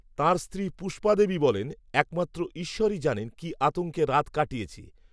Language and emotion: Bengali, neutral